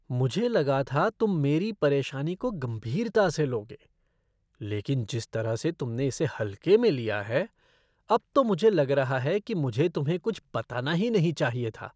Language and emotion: Hindi, disgusted